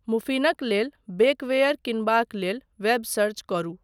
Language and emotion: Maithili, neutral